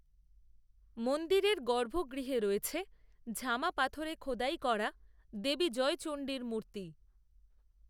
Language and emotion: Bengali, neutral